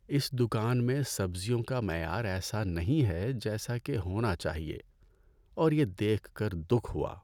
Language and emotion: Urdu, sad